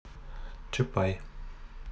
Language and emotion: Russian, neutral